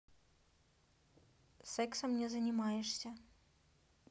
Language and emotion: Russian, neutral